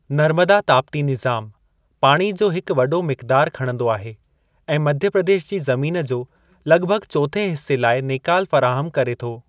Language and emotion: Sindhi, neutral